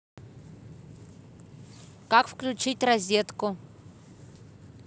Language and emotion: Russian, neutral